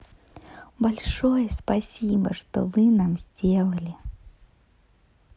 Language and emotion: Russian, positive